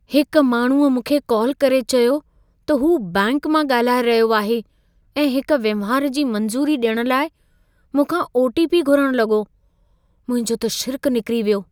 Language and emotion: Sindhi, fearful